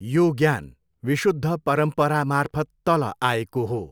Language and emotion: Nepali, neutral